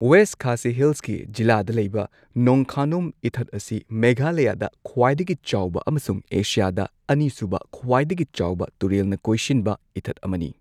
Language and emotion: Manipuri, neutral